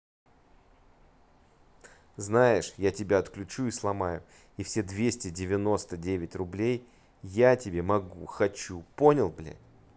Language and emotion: Russian, angry